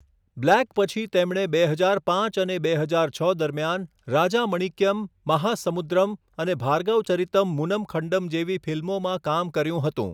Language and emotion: Gujarati, neutral